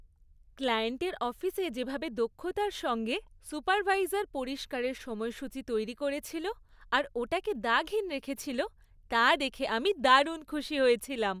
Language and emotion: Bengali, happy